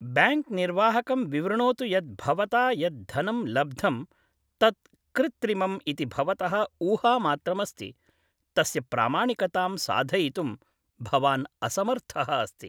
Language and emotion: Sanskrit, neutral